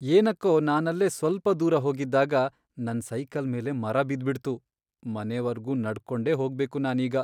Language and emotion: Kannada, sad